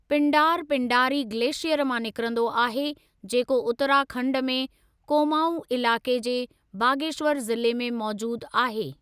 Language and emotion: Sindhi, neutral